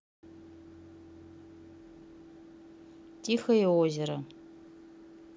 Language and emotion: Russian, neutral